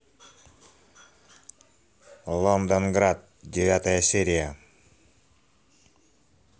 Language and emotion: Russian, neutral